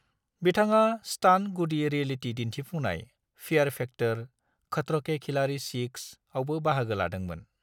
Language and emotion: Bodo, neutral